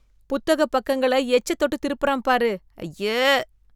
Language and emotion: Tamil, disgusted